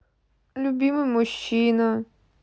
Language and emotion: Russian, neutral